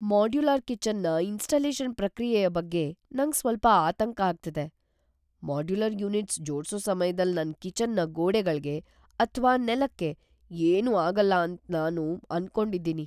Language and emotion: Kannada, fearful